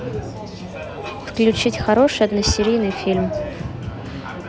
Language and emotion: Russian, neutral